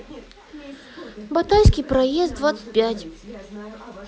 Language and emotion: Russian, sad